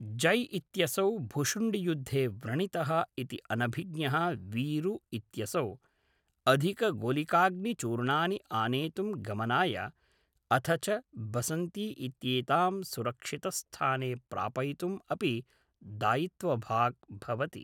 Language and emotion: Sanskrit, neutral